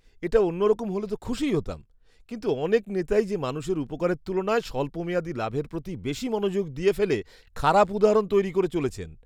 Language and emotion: Bengali, disgusted